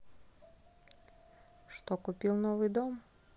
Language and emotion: Russian, neutral